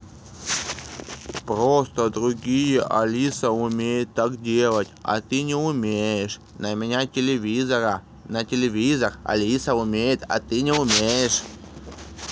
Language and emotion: Russian, angry